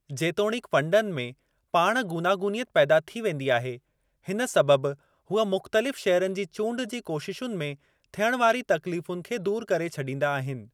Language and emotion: Sindhi, neutral